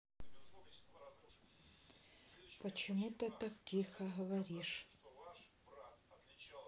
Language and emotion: Russian, sad